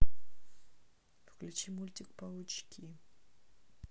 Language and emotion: Russian, neutral